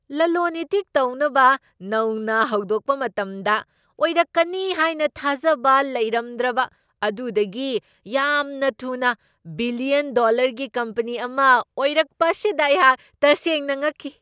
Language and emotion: Manipuri, surprised